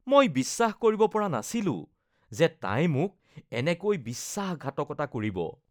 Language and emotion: Assamese, disgusted